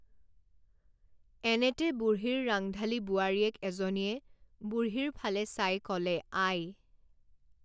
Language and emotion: Assamese, neutral